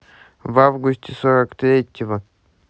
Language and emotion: Russian, neutral